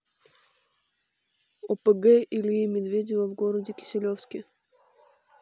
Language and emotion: Russian, neutral